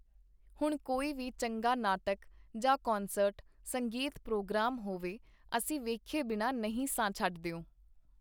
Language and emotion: Punjabi, neutral